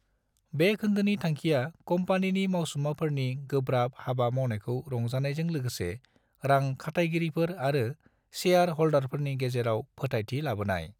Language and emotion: Bodo, neutral